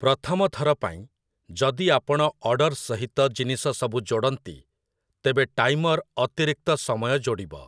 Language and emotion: Odia, neutral